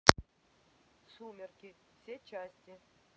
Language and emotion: Russian, neutral